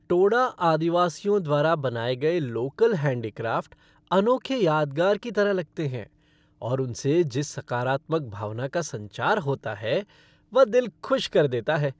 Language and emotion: Hindi, happy